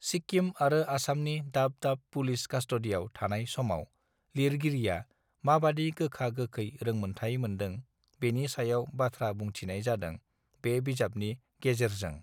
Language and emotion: Bodo, neutral